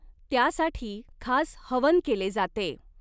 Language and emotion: Marathi, neutral